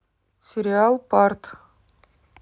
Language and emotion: Russian, neutral